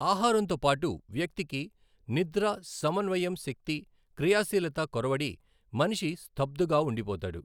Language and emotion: Telugu, neutral